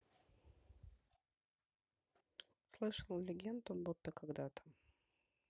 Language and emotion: Russian, neutral